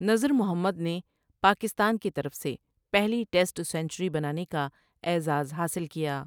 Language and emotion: Urdu, neutral